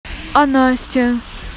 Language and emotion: Russian, neutral